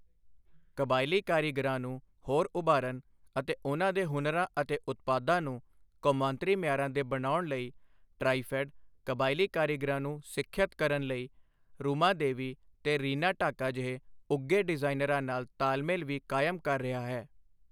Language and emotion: Punjabi, neutral